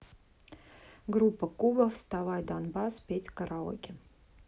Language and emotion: Russian, neutral